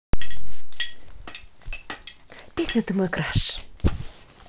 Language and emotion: Russian, positive